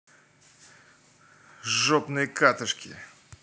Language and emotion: Russian, angry